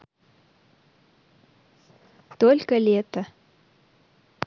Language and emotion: Russian, positive